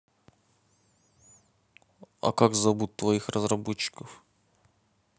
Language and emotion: Russian, neutral